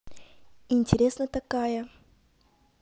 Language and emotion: Russian, positive